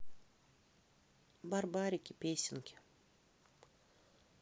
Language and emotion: Russian, neutral